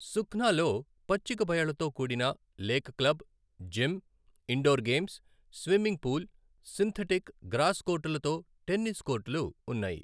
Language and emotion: Telugu, neutral